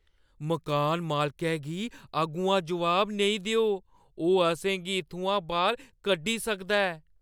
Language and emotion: Dogri, fearful